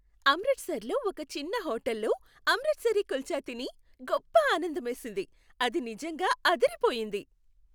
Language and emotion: Telugu, happy